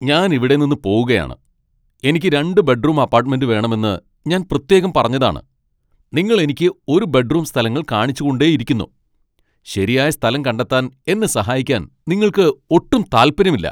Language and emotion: Malayalam, angry